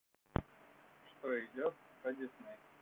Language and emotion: Russian, neutral